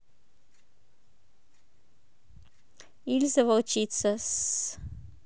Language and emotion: Russian, neutral